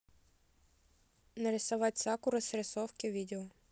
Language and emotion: Russian, neutral